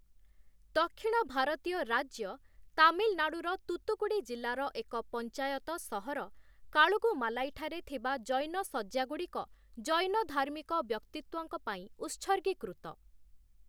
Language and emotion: Odia, neutral